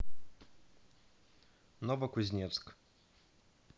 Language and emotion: Russian, neutral